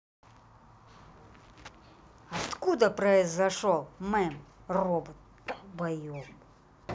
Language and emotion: Russian, angry